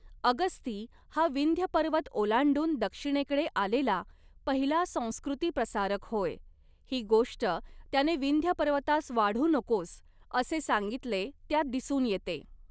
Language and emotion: Marathi, neutral